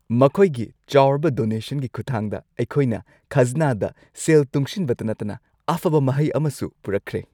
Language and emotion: Manipuri, happy